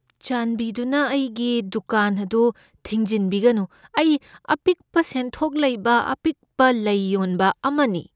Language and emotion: Manipuri, fearful